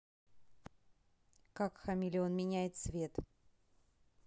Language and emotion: Russian, neutral